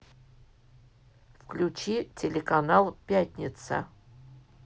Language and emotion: Russian, neutral